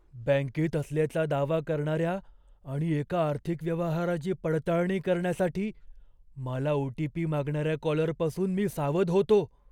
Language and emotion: Marathi, fearful